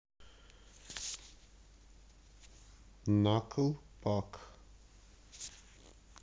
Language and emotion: Russian, neutral